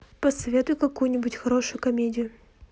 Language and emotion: Russian, neutral